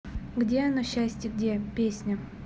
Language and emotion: Russian, neutral